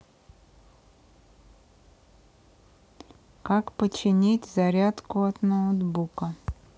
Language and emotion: Russian, neutral